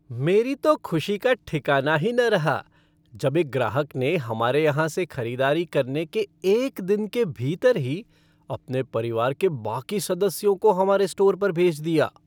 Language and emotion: Hindi, happy